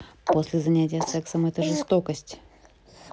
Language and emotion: Russian, neutral